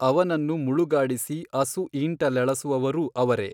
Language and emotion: Kannada, neutral